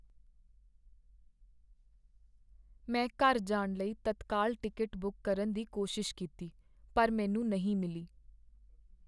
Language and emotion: Punjabi, sad